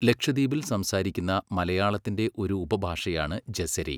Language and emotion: Malayalam, neutral